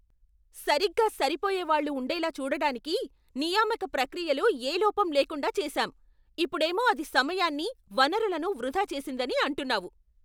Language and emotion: Telugu, angry